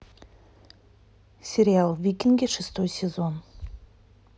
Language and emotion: Russian, neutral